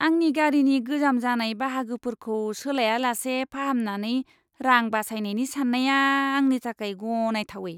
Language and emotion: Bodo, disgusted